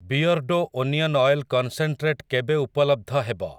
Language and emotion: Odia, neutral